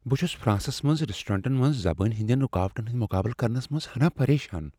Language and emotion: Kashmiri, fearful